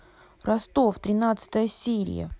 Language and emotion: Russian, angry